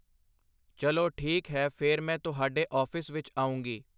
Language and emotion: Punjabi, neutral